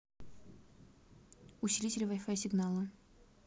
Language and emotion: Russian, neutral